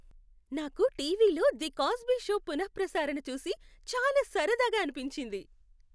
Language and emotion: Telugu, happy